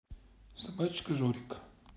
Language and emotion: Russian, neutral